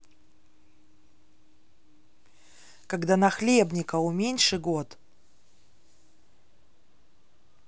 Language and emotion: Russian, neutral